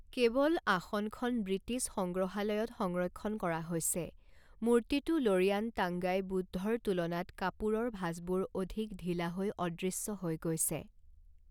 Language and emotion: Assamese, neutral